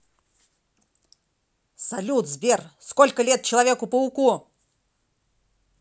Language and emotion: Russian, angry